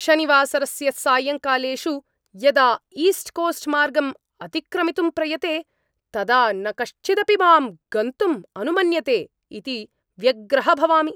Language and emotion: Sanskrit, angry